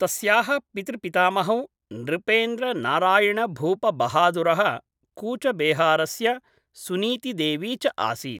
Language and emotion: Sanskrit, neutral